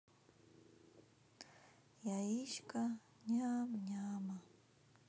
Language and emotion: Russian, neutral